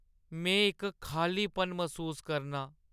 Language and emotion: Dogri, sad